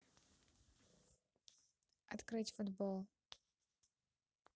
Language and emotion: Russian, neutral